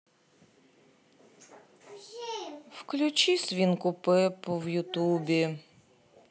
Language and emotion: Russian, sad